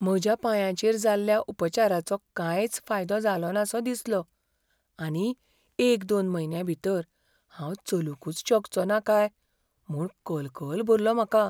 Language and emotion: Goan Konkani, fearful